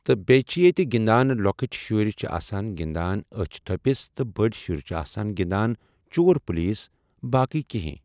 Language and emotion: Kashmiri, neutral